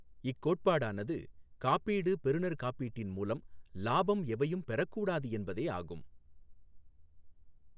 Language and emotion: Tamil, neutral